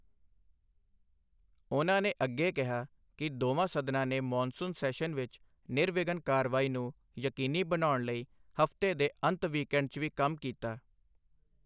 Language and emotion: Punjabi, neutral